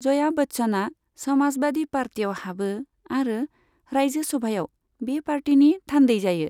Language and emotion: Bodo, neutral